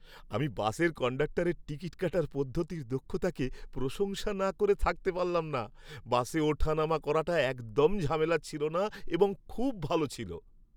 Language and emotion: Bengali, happy